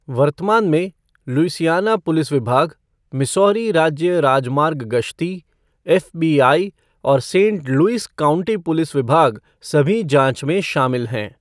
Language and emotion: Hindi, neutral